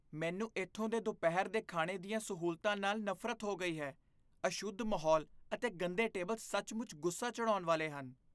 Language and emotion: Punjabi, disgusted